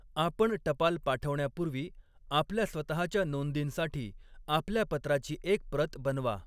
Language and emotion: Marathi, neutral